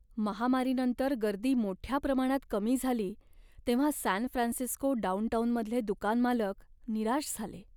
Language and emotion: Marathi, sad